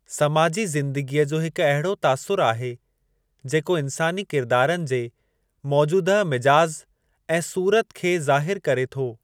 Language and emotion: Sindhi, neutral